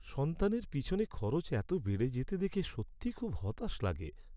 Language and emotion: Bengali, sad